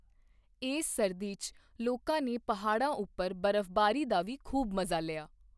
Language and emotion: Punjabi, neutral